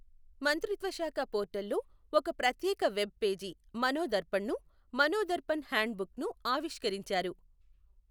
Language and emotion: Telugu, neutral